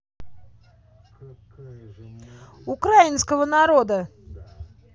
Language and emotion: Russian, angry